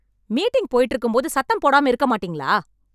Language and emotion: Tamil, angry